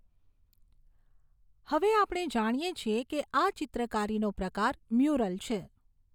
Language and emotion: Gujarati, neutral